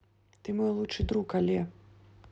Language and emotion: Russian, neutral